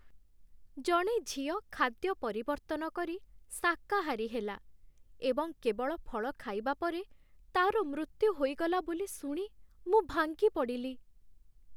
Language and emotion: Odia, sad